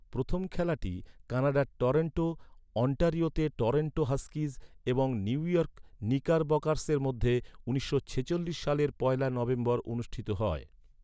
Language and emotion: Bengali, neutral